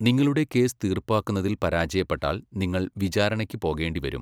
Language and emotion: Malayalam, neutral